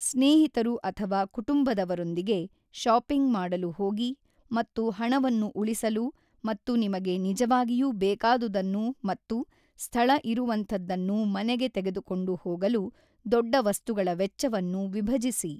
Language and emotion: Kannada, neutral